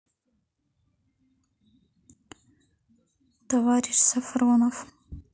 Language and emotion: Russian, neutral